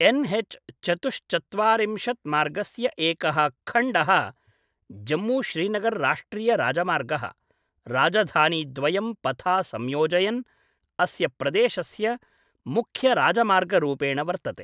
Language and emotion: Sanskrit, neutral